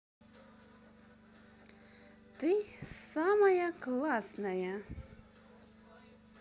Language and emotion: Russian, positive